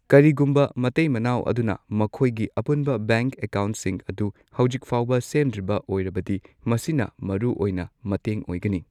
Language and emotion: Manipuri, neutral